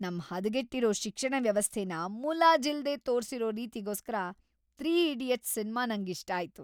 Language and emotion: Kannada, happy